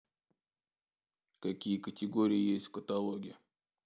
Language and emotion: Russian, neutral